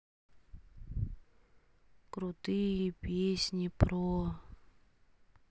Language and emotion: Russian, sad